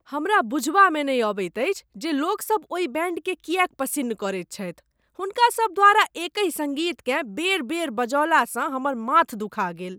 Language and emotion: Maithili, disgusted